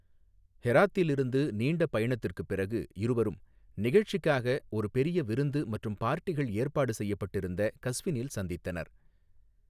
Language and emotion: Tamil, neutral